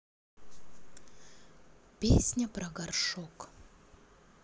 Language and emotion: Russian, neutral